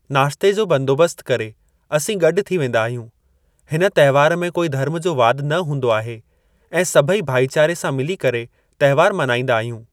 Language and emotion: Sindhi, neutral